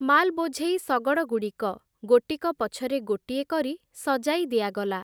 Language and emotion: Odia, neutral